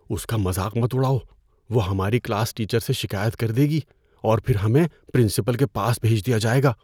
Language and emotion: Urdu, fearful